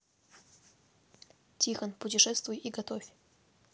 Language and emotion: Russian, neutral